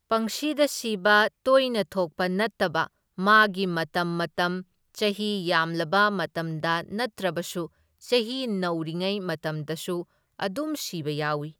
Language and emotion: Manipuri, neutral